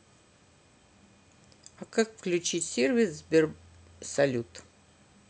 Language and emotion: Russian, neutral